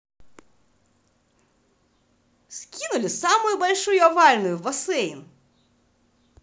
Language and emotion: Russian, positive